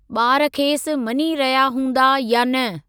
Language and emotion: Sindhi, neutral